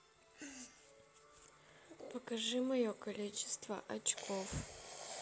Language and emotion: Russian, neutral